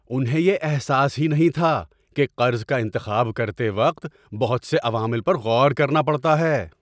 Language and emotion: Urdu, surprised